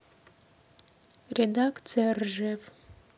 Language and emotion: Russian, neutral